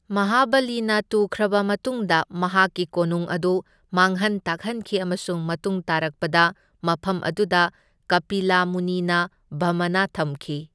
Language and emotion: Manipuri, neutral